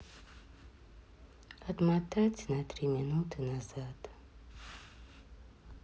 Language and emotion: Russian, sad